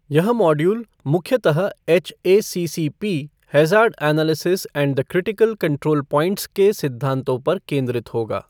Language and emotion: Hindi, neutral